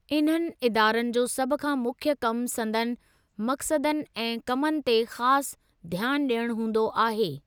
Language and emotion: Sindhi, neutral